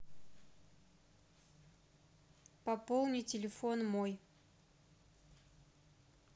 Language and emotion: Russian, neutral